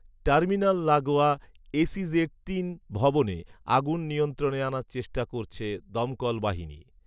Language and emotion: Bengali, neutral